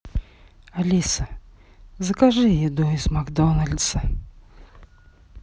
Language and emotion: Russian, sad